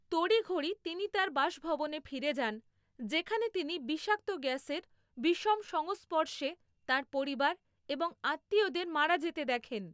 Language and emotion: Bengali, neutral